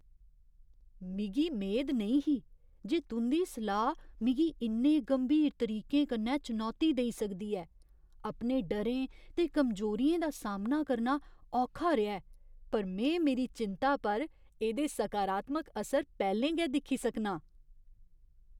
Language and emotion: Dogri, surprised